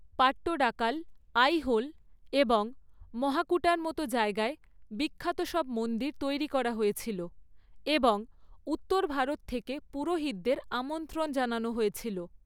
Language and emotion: Bengali, neutral